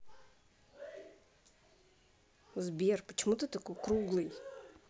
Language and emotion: Russian, neutral